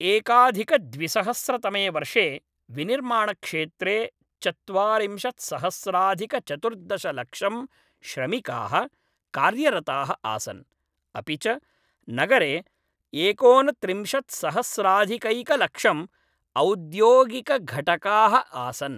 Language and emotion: Sanskrit, neutral